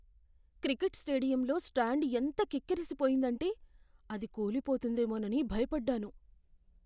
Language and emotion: Telugu, fearful